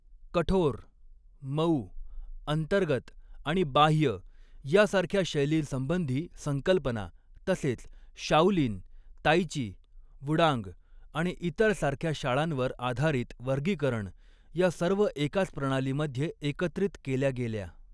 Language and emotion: Marathi, neutral